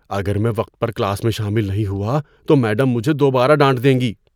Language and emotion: Urdu, fearful